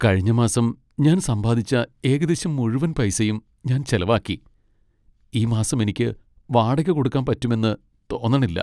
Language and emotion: Malayalam, sad